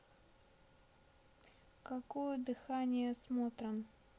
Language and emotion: Russian, neutral